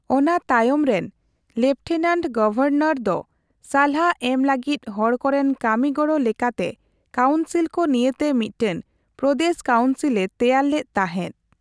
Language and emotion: Santali, neutral